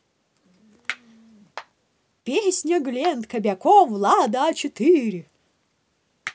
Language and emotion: Russian, positive